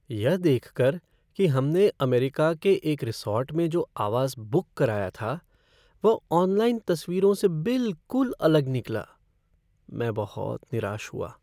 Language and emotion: Hindi, sad